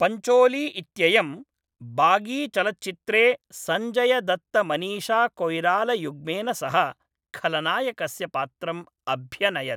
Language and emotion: Sanskrit, neutral